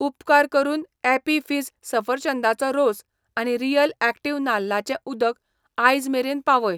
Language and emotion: Goan Konkani, neutral